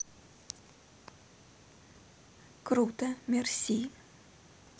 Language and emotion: Russian, neutral